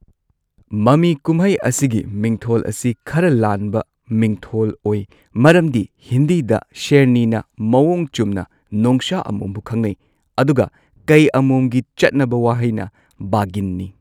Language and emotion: Manipuri, neutral